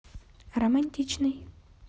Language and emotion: Russian, neutral